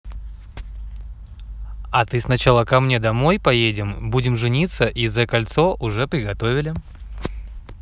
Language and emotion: Russian, positive